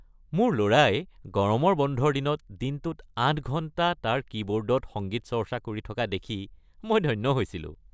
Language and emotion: Assamese, happy